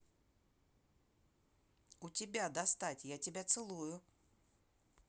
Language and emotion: Russian, neutral